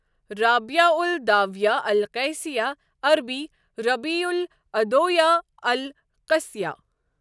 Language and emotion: Kashmiri, neutral